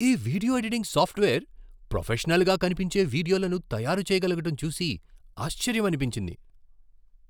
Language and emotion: Telugu, surprised